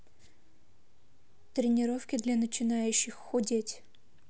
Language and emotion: Russian, neutral